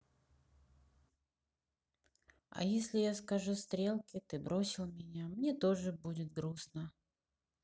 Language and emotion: Russian, sad